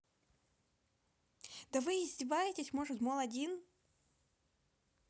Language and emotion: Russian, angry